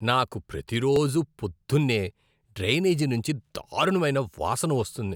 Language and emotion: Telugu, disgusted